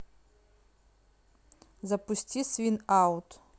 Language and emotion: Russian, neutral